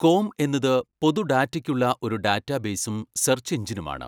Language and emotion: Malayalam, neutral